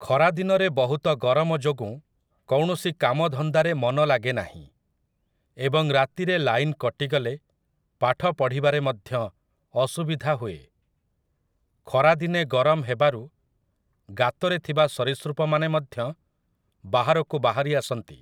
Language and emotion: Odia, neutral